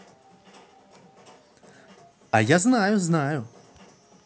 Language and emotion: Russian, positive